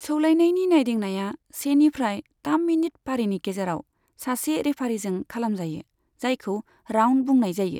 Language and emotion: Bodo, neutral